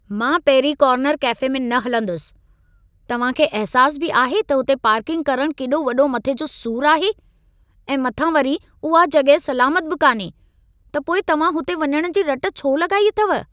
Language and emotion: Sindhi, angry